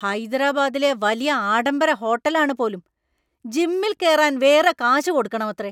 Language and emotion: Malayalam, angry